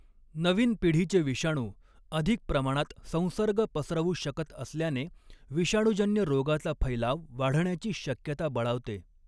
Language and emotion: Marathi, neutral